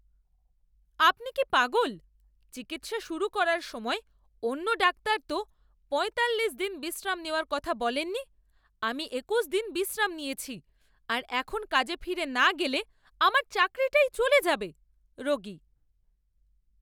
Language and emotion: Bengali, angry